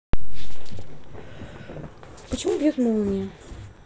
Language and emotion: Russian, neutral